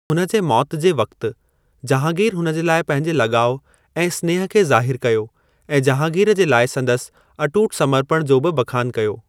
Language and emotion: Sindhi, neutral